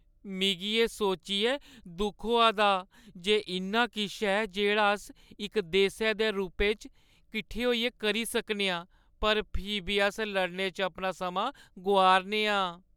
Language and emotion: Dogri, sad